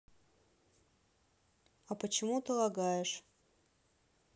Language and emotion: Russian, neutral